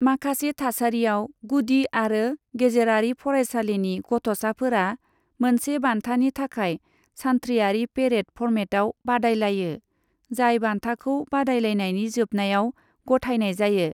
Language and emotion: Bodo, neutral